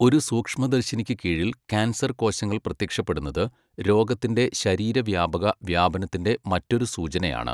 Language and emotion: Malayalam, neutral